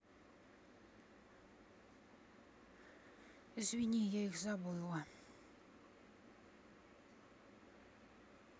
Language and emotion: Russian, sad